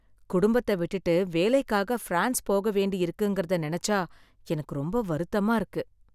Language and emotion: Tamil, sad